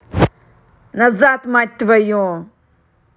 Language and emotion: Russian, angry